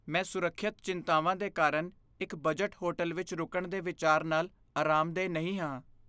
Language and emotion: Punjabi, fearful